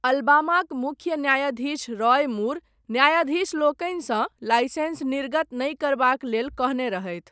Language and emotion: Maithili, neutral